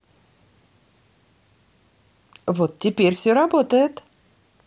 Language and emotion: Russian, positive